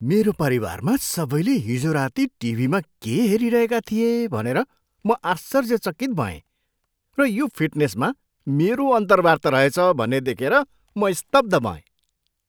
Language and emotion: Nepali, surprised